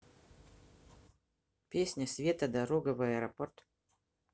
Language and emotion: Russian, neutral